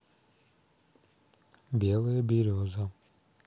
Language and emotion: Russian, neutral